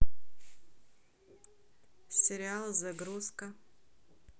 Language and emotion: Russian, neutral